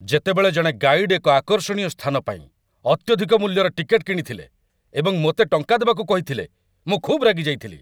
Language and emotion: Odia, angry